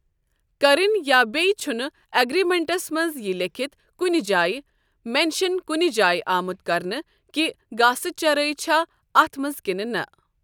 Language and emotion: Kashmiri, neutral